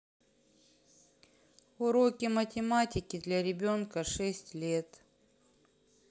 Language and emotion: Russian, sad